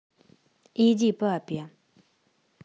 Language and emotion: Russian, neutral